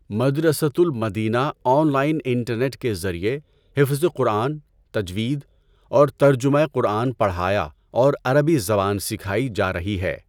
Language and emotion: Urdu, neutral